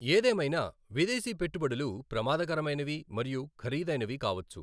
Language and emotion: Telugu, neutral